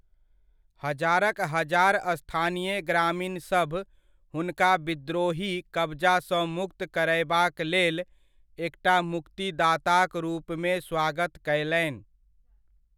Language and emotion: Maithili, neutral